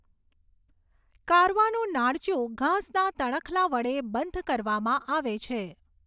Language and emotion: Gujarati, neutral